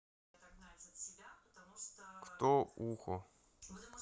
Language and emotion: Russian, neutral